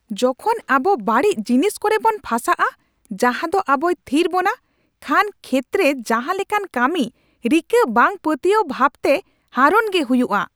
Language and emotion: Santali, angry